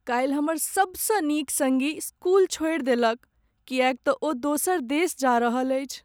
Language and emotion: Maithili, sad